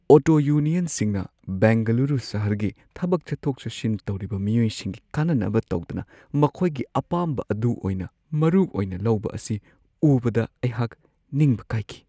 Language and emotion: Manipuri, sad